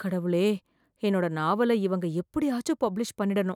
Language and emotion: Tamil, fearful